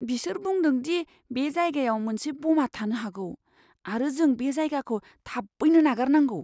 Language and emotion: Bodo, fearful